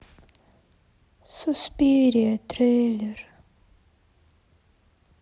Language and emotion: Russian, sad